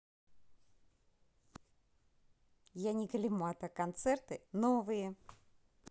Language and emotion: Russian, positive